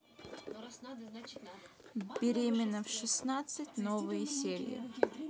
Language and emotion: Russian, neutral